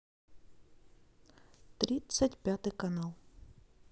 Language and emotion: Russian, neutral